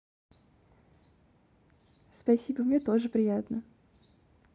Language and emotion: Russian, positive